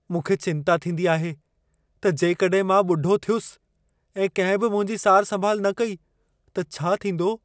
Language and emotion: Sindhi, fearful